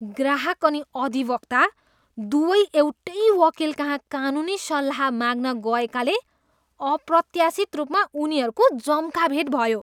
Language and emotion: Nepali, disgusted